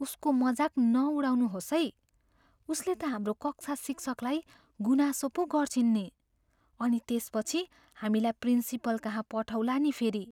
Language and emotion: Nepali, fearful